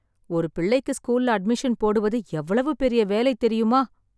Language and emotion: Tamil, sad